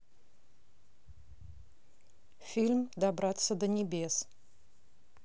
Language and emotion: Russian, neutral